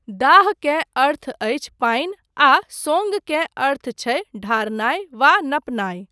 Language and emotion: Maithili, neutral